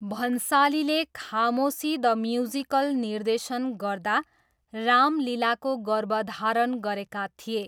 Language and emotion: Nepali, neutral